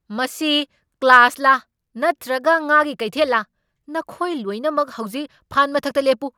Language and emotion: Manipuri, angry